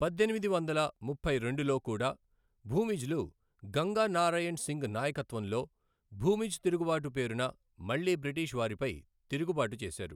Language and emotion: Telugu, neutral